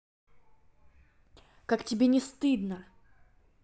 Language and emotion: Russian, angry